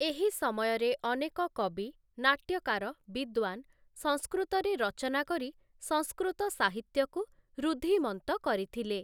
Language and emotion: Odia, neutral